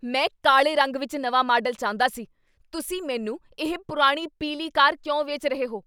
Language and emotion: Punjabi, angry